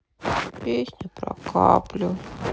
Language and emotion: Russian, sad